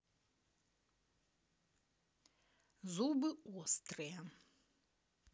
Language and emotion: Russian, neutral